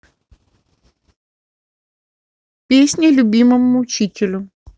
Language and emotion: Russian, neutral